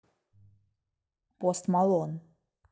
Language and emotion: Russian, neutral